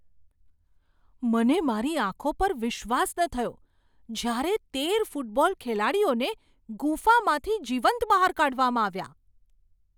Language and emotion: Gujarati, surprised